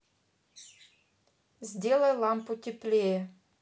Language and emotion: Russian, neutral